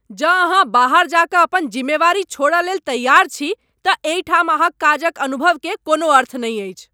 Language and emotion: Maithili, angry